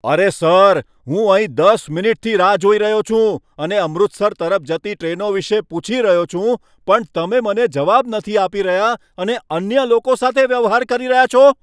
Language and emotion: Gujarati, angry